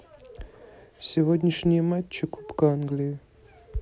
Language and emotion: Russian, neutral